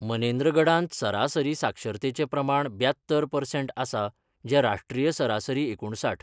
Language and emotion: Goan Konkani, neutral